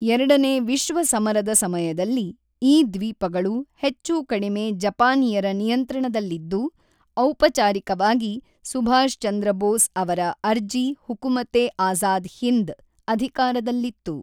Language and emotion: Kannada, neutral